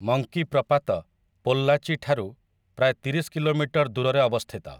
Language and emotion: Odia, neutral